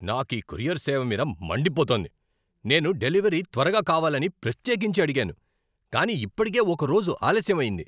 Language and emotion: Telugu, angry